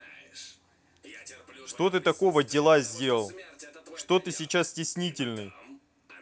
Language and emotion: Russian, angry